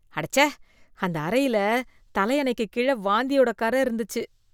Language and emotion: Tamil, disgusted